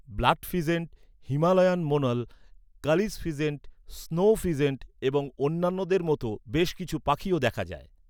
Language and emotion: Bengali, neutral